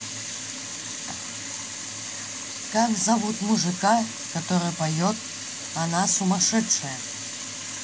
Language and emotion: Russian, neutral